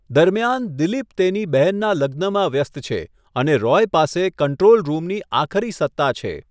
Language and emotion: Gujarati, neutral